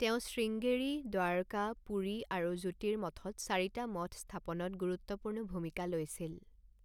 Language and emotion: Assamese, neutral